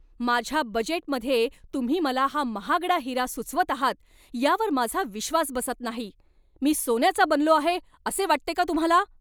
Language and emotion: Marathi, angry